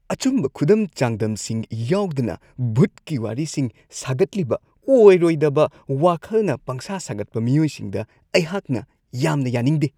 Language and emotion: Manipuri, disgusted